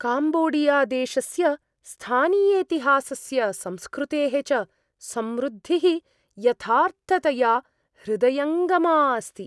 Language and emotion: Sanskrit, surprised